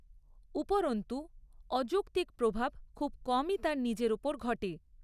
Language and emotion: Bengali, neutral